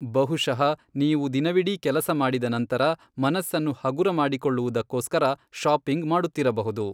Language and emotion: Kannada, neutral